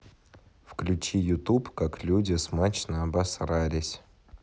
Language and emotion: Russian, neutral